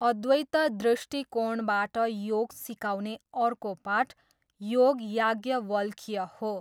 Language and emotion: Nepali, neutral